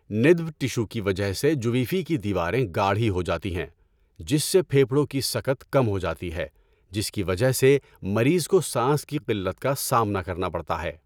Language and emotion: Urdu, neutral